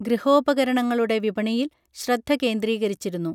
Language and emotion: Malayalam, neutral